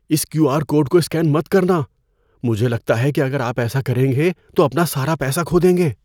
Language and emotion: Urdu, fearful